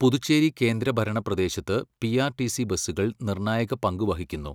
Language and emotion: Malayalam, neutral